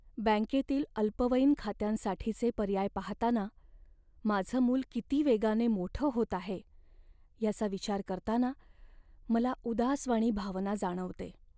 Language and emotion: Marathi, sad